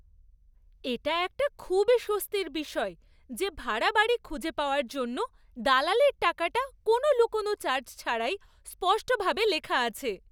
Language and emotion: Bengali, happy